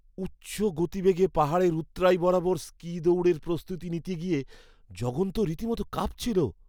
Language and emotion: Bengali, fearful